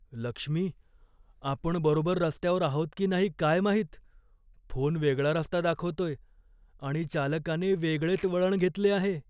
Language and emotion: Marathi, fearful